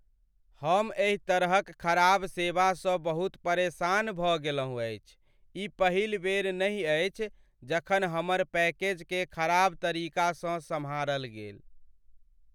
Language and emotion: Maithili, sad